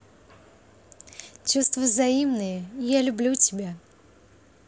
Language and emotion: Russian, positive